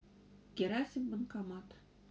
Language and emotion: Russian, neutral